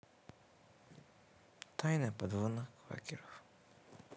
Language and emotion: Russian, sad